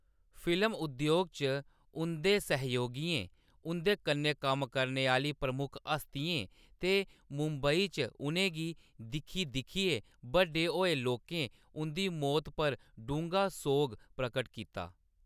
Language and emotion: Dogri, neutral